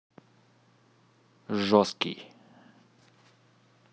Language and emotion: Russian, neutral